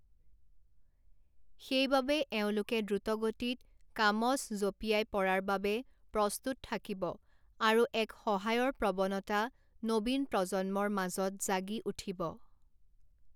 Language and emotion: Assamese, neutral